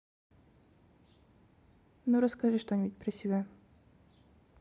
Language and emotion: Russian, neutral